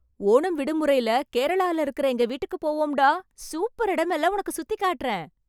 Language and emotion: Tamil, happy